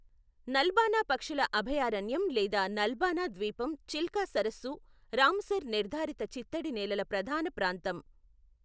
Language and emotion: Telugu, neutral